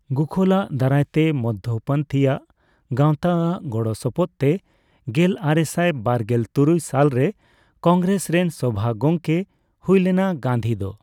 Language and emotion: Santali, neutral